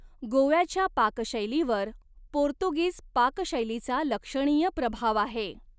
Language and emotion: Marathi, neutral